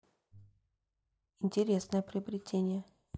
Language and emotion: Russian, neutral